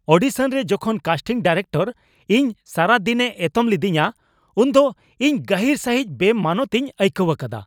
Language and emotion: Santali, angry